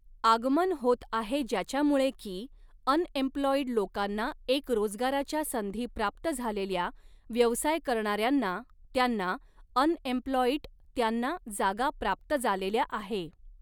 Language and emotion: Marathi, neutral